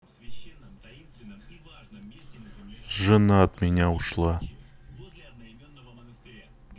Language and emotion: Russian, sad